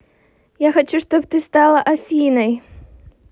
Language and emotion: Russian, positive